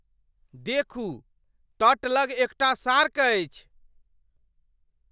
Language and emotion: Maithili, surprised